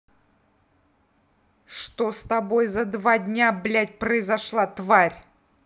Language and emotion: Russian, angry